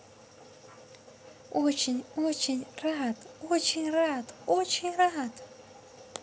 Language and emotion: Russian, positive